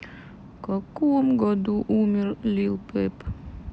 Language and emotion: Russian, sad